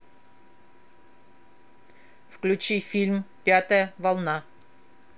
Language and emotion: Russian, neutral